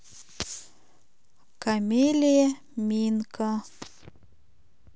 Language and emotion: Russian, neutral